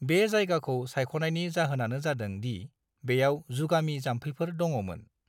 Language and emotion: Bodo, neutral